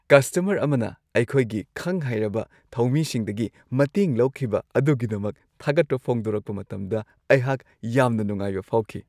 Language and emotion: Manipuri, happy